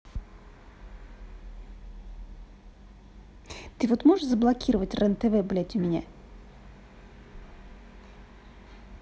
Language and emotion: Russian, angry